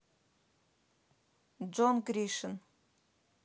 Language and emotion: Russian, neutral